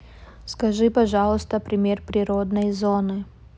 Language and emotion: Russian, neutral